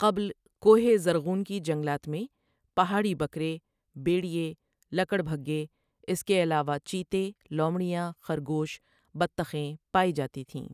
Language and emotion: Urdu, neutral